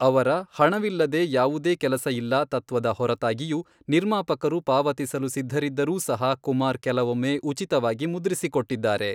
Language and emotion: Kannada, neutral